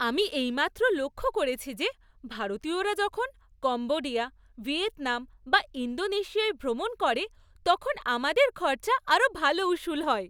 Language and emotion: Bengali, happy